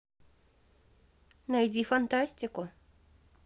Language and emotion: Russian, neutral